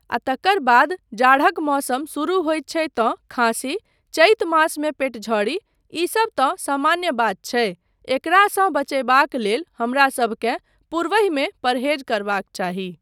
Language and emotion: Maithili, neutral